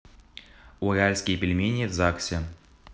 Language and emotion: Russian, neutral